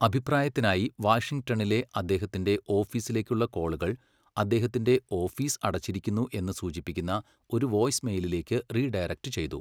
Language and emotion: Malayalam, neutral